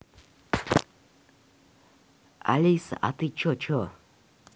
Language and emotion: Russian, neutral